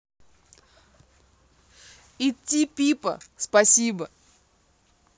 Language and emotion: Russian, positive